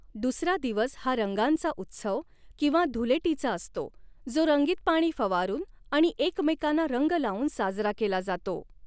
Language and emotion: Marathi, neutral